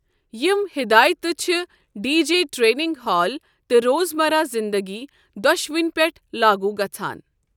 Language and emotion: Kashmiri, neutral